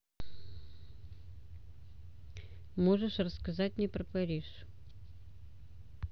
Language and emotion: Russian, neutral